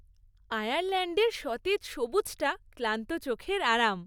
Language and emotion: Bengali, happy